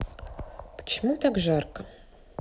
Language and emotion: Russian, neutral